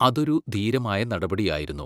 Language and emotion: Malayalam, neutral